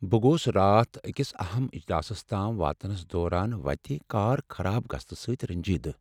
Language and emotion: Kashmiri, sad